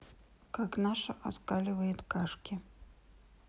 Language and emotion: Russian, sad